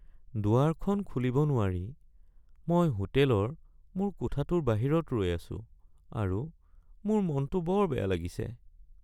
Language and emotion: Assamese, sad